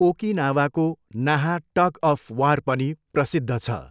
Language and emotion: Nepali, neutral